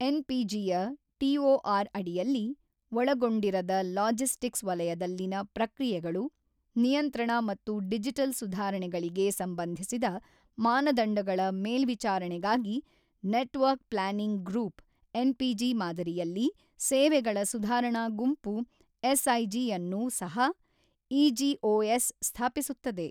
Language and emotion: Kannada, neutral